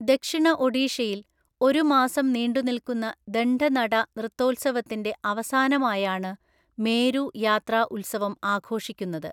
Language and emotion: Malayalam, neutral